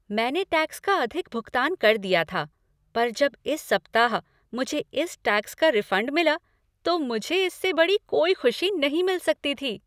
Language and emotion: Hindi, happy